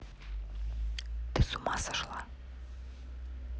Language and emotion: Russian, neutral